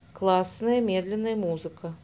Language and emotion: Russian, neutral